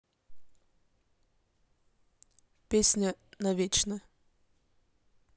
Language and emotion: Russian, neutral